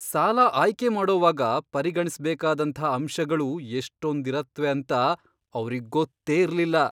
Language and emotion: Kannada, surprised